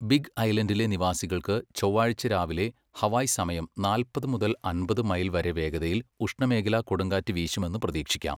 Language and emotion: Malayalam, neutral